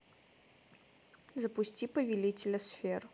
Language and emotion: Russian, neutral